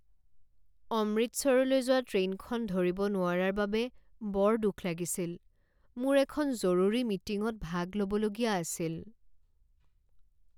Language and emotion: Assamese, sad